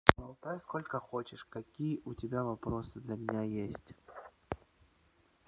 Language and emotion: Russian, neutral